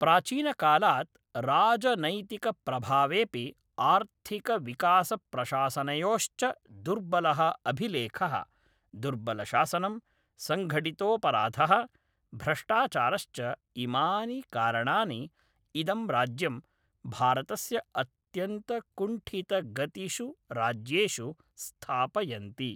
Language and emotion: Sanskrit, neutral